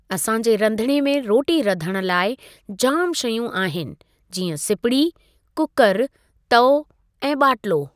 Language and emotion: Sindhi, neutral